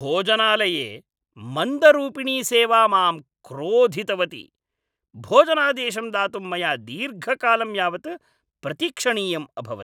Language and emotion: Sanskrit, angry